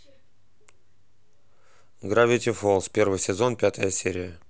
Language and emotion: Russian, neutral